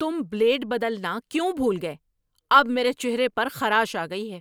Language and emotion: Urdu, angry